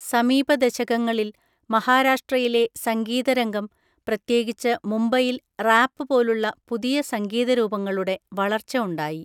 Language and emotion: Malayalam, neutral